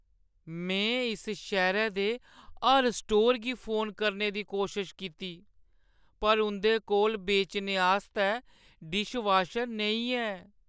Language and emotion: Dogri, sad